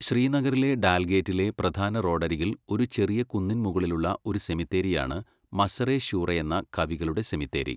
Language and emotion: Malayalam, neutral